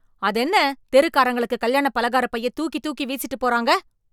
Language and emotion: Tamil, angry